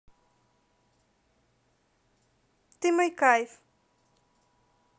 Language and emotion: Russian, positive